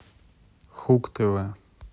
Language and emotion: Russian, neutral